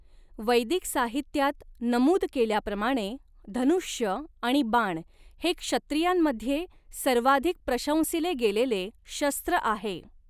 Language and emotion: Marathi, neutral